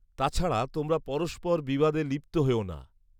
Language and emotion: Bengali, neutral